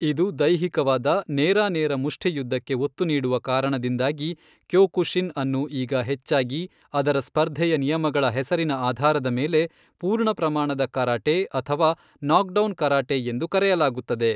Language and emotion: Kannada, neutral